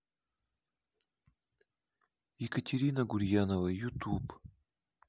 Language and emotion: Russian, neutral